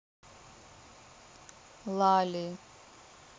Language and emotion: Russian, neutral